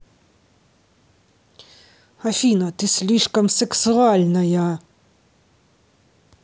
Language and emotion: Russian, angry